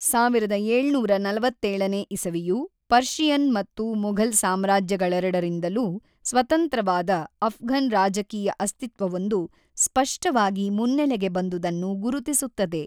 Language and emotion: Kannada, neutral